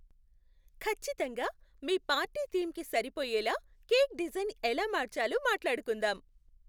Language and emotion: Telugu, happy